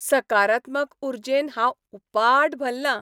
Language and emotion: Goan Konkani, happy